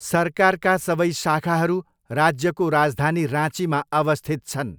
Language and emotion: Nepali, neutral